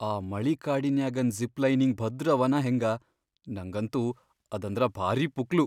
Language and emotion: Kannada, fearful